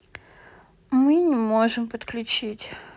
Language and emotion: Russian, sad